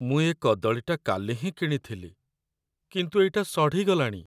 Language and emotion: Odia, sad